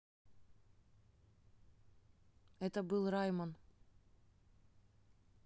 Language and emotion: Russian, neutral